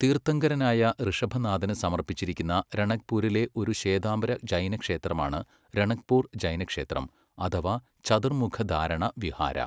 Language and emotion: Malayalam, neutral